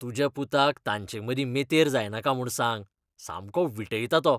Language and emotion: Goan Konkani, disgusted